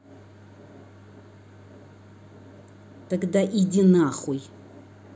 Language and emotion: Russian, angry